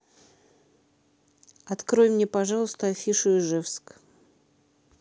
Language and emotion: Russian, neutral